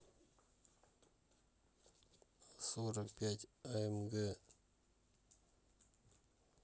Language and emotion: Russian, neutral